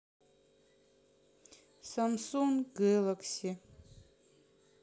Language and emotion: Russian, sad